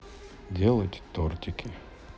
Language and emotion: Russian, neutral